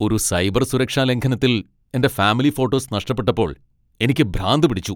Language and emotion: Malayalam, angry